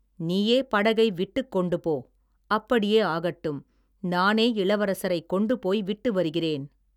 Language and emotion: Tamil, neutral